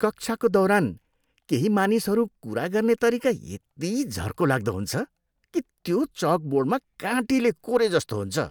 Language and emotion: Nepali, disgusted